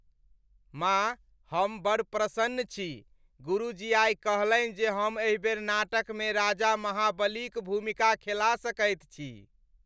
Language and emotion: Maithili, happy